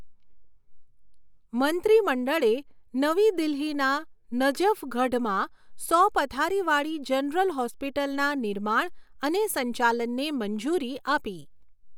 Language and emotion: Gujarati, neutral